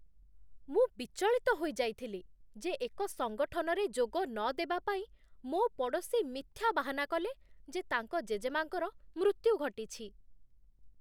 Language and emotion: Odia, disgusted